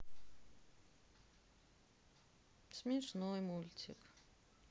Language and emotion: Russian, sad